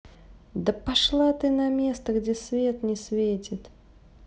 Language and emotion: Russian, angry